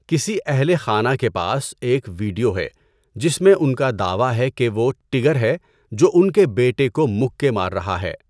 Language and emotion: Urdu, neutral